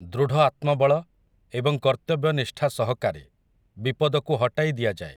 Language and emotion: Odia, neutral